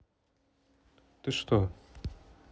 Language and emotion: Russian, neutral